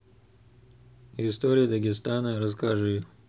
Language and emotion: Russian, neutral